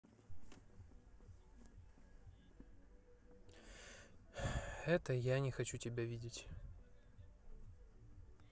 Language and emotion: Russian, sad